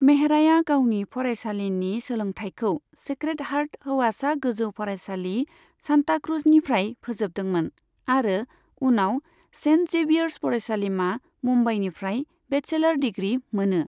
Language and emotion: Bodo, neutral